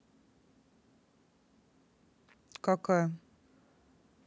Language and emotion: Russian, neutral